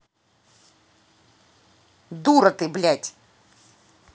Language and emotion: Russian, angry